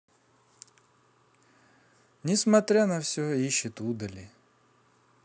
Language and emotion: Russian, neutral